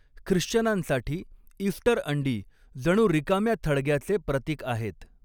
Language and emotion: Marathi, neutral